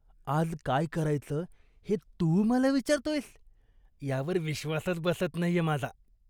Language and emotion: Marathi, disgusted